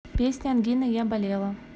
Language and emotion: Russian, neutral